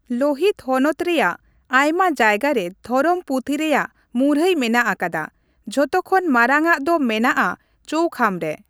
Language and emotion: Santali, neutral